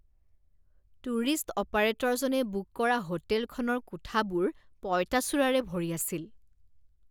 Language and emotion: Assamese, disgusted